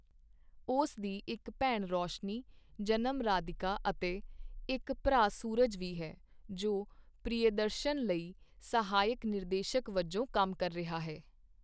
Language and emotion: Punjabi, neutral